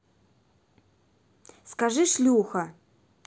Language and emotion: Russian, neutral